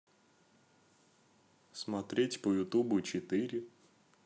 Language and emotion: Russian, neutral